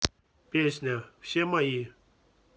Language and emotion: Russian, neutral